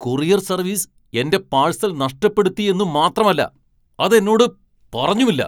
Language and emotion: Malayalam, angry